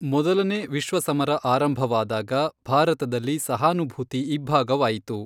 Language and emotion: Kannada, neutral